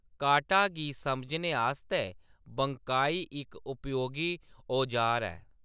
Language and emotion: Dogri, neutral